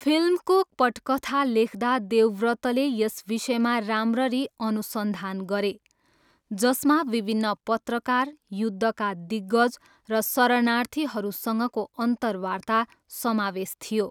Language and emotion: Nepali, neutral